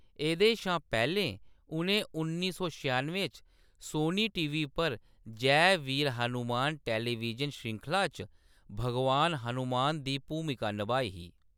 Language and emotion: Dogri, neutral